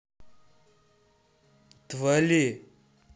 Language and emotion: Russian, angry